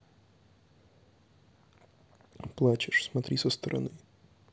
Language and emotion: Russian, neutral